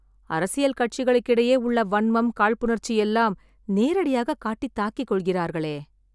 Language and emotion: Tamil, sad